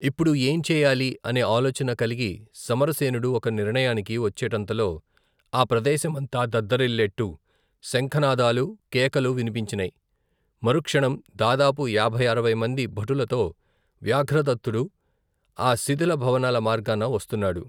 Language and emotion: Telugu, neutral